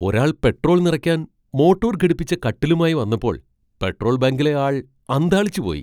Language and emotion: Malayalam, surprised